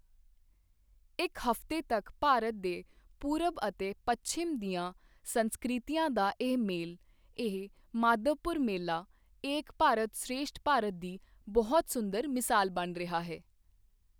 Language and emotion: Punjabi, neutral